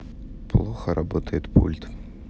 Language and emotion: Russian, neutral